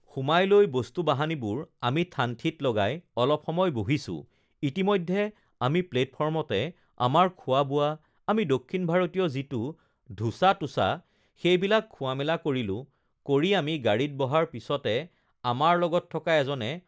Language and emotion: Assamese, neutral